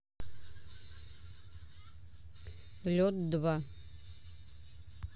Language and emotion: Russian, neutral